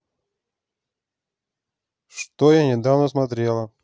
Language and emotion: Russian, neutral